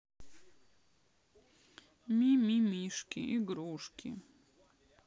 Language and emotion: Russian, sad